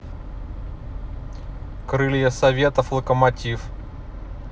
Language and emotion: Russian, neutral